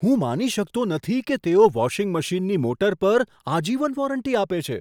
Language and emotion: Gujarati, surprised